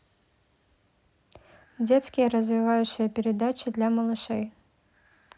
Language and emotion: Russian, neutral